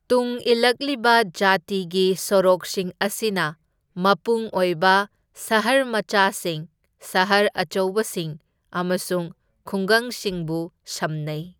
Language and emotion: Manipuri, neutral